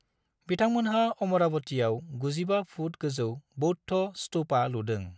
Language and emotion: Bodo, neutral